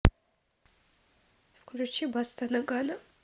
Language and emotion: Russian, neutral